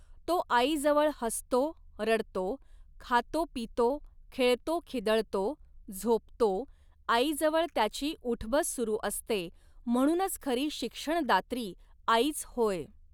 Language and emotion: Marathi, neutral